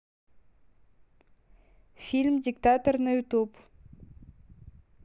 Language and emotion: Russian, neutral